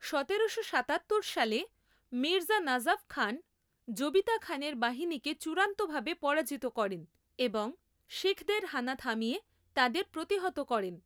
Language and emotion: Bengali, neutral